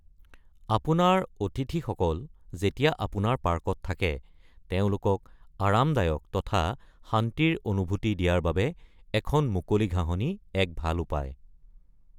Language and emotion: Assamese, neutral